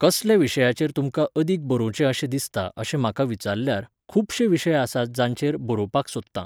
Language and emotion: Goan Konkani, neutral